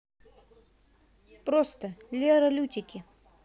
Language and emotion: Russian, positive